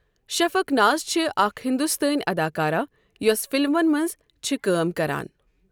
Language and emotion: Kashmiri, neutral